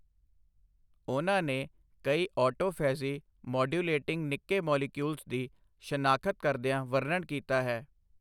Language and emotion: Punjabi, neutral